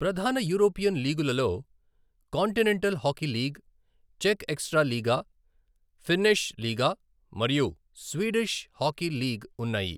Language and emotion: Telugu, neutral